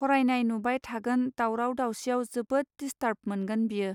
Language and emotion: Bodo, neutral